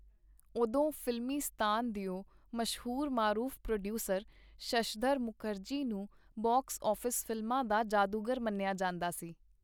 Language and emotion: Punjabi, neutral